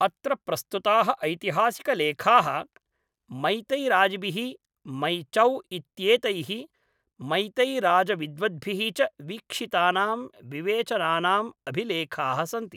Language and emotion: Sanskrit, neutral